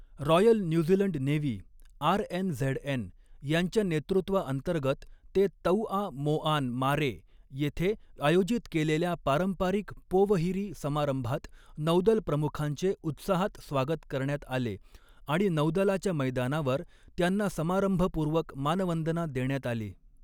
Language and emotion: Marathi, neutral